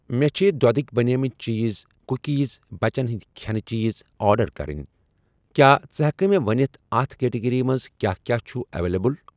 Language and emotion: Kashmiri, neutral